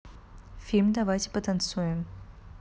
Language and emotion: Russian, neutral